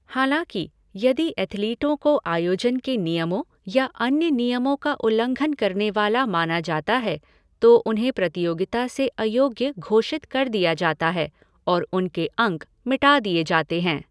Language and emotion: Hindi, neutral